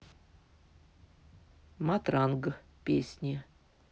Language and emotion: Russian, neutral